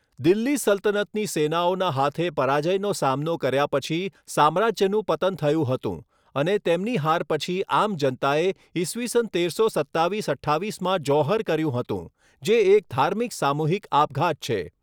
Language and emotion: Gujarati, neutral